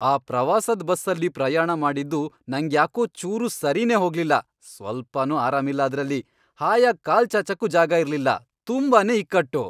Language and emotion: Kannada, angry